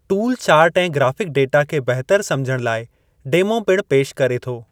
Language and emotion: Sindhi, neutral